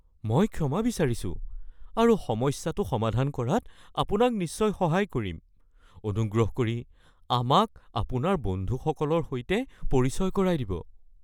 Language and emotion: Assamese, fearful